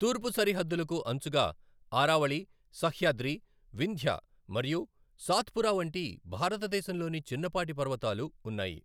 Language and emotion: Telugu, neutral